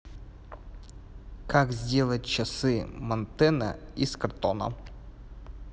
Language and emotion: Russian, neutral